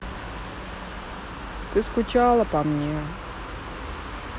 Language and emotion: Russian, sad